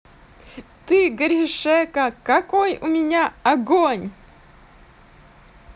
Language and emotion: Russian, positive